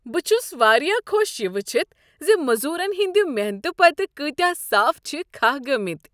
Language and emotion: Kashmiri, happy